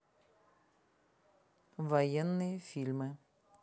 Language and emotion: Russian, neutral